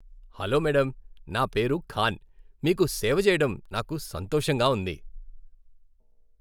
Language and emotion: Telugu, happy